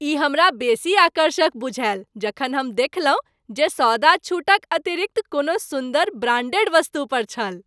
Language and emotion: Maithili, happy